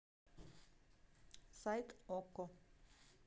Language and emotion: Russian, neutral